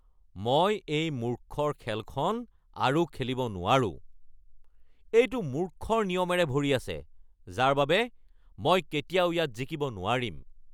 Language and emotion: Assamese, angry